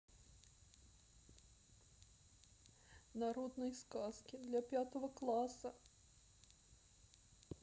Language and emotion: Russian, sad